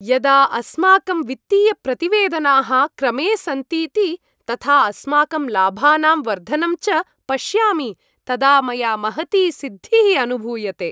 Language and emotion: Sanskrit, happy